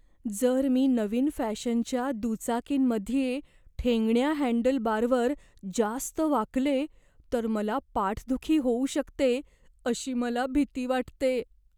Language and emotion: Marathi, fearful